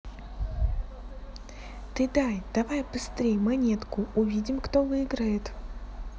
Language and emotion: Russian, neutral